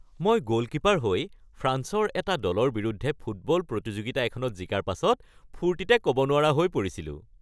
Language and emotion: Assamese, happy